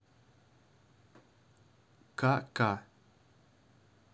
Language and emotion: Russian, neutral